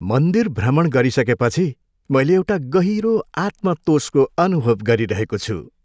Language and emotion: Nepali, happy